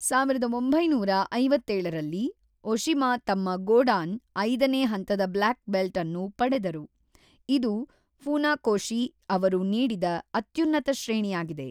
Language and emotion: Kannada, neutral